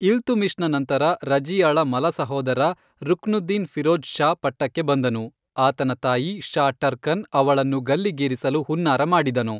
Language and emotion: Kannada, neutral